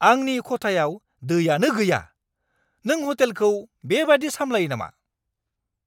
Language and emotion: Bodo, angry